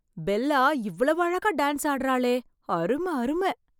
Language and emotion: Tamil, surprised